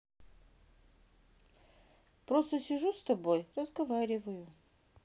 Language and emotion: Russian, sad